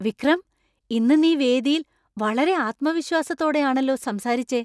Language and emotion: Malayalam, surprised